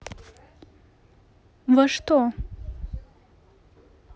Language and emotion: Russian, neutral